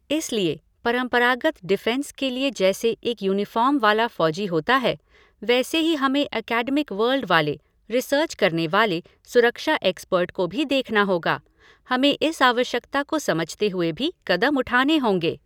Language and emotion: Hindi, neutral